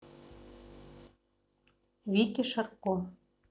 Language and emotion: Russian, neutral